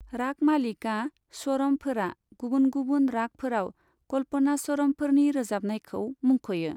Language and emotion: Bodo, neutral